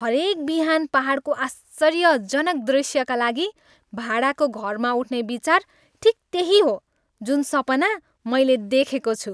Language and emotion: Nepali, happy